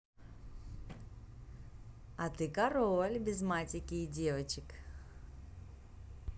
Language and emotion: Russian, positive